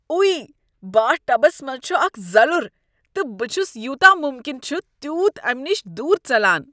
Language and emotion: Kashmiri, disgusted